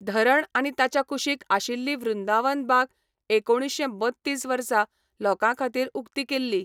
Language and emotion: Goan Konkani, neutral